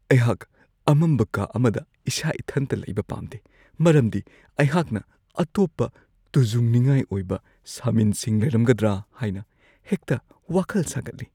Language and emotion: Manipuri, fearful